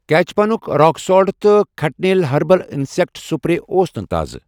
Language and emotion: Kashmiri, neutral